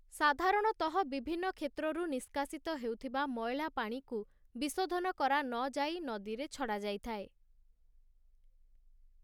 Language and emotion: Odia, neutral